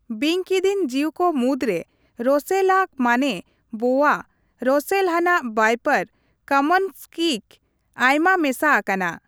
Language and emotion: Santali, neutral